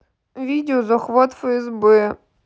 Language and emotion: Russian, sad